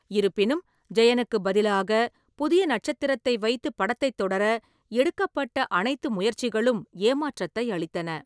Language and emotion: Tamil, neutral